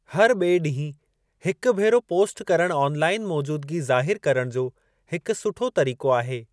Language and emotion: Sindhi, neutral